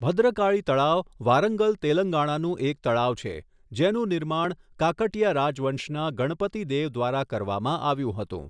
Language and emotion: Gujarati, neutral